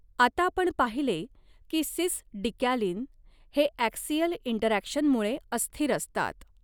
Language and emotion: Marathi, neutral